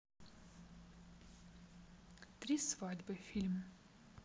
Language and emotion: Russian, neutral